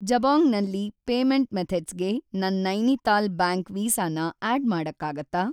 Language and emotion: Kannada, neutral